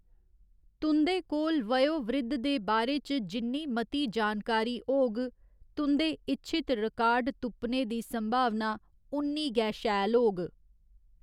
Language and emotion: Dogri, neutral